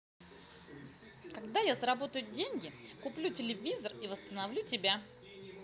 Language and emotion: Russian, positive